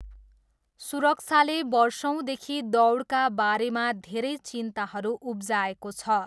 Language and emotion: Nepali, neutral